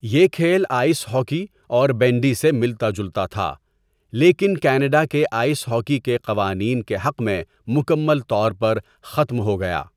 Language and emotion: Urdu, neutral